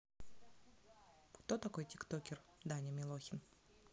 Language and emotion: Russian, neutral